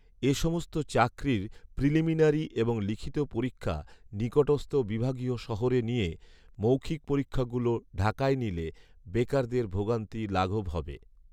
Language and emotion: Bengali, neutral